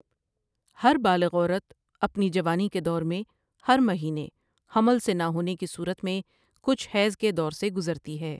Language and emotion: Urdu, neutral